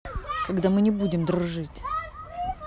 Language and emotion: Russian, angry